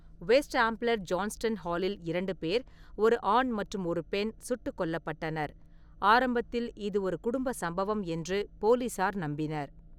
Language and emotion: Tamil, neutral